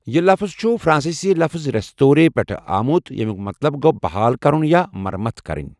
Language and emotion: Kashmiri, neutral